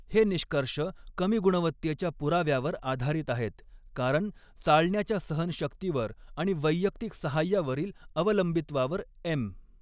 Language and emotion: Marathi, neutral